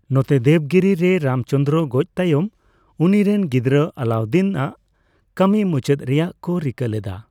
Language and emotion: Santali, neutral